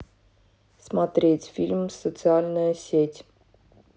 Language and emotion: Russian, neutral